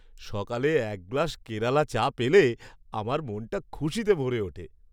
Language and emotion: Bengali, happy